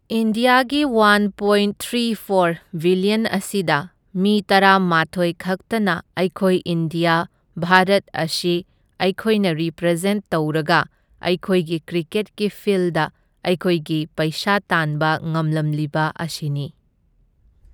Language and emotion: Manipuri, neutral